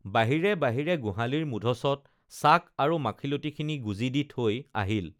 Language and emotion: Assamese, neutral